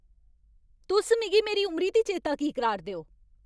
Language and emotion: Dogri, angry